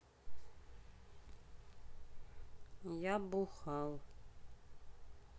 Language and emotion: Russian, sad